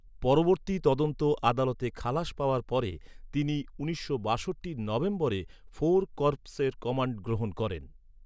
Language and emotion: Bengali, neutral